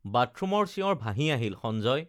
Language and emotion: Assamese, neutral